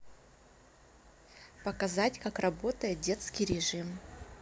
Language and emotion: Russian, neutral